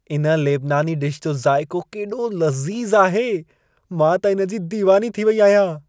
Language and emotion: Sindhi, happy